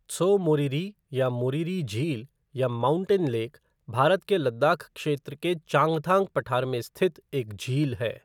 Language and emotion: Hindi, neutral